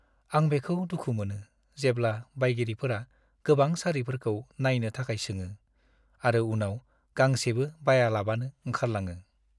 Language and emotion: Bodo, sad